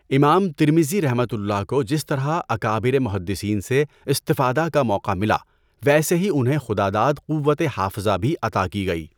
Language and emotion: Urdu, neutral